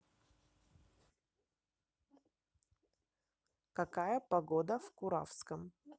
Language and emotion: Russian, neutral